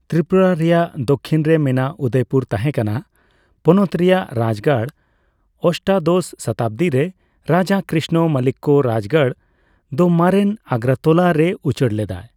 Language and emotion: Santali, neutral